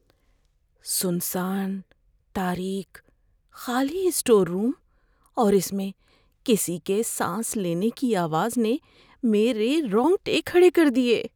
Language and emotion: Urdu, fearful